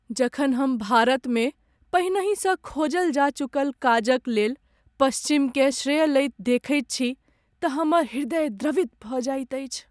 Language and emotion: Maithili, sad